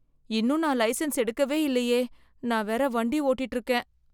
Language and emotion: Tamil, fearful